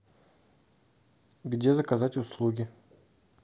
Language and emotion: Russian, neutral